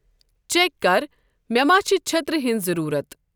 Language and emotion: Kashmiri, neutral